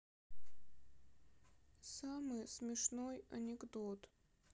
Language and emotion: Russian, sad